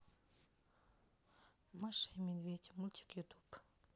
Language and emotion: Russian, neutral